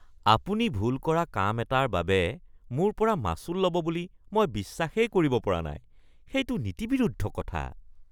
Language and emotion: Assamese, disgusted